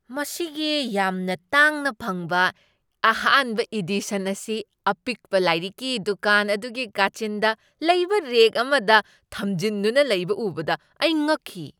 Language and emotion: Manipuri, surprised